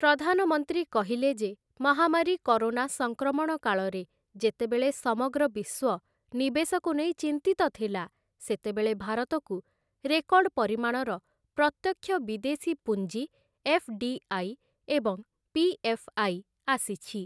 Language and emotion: Odia, neutral